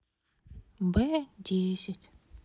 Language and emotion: Russian, sad